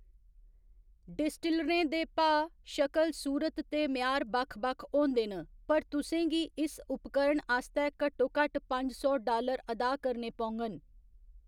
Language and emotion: Dogri, neutral